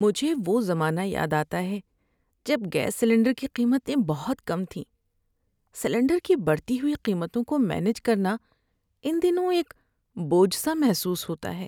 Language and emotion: Urdu, sad